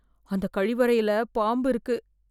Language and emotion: Tamil, fearful